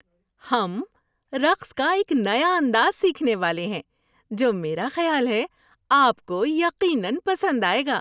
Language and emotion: Urdu, happy